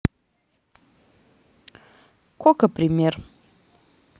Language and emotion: Russian, neutral